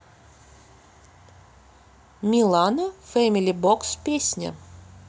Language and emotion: Russian, neutral